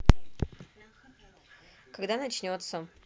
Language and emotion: Russian, neutral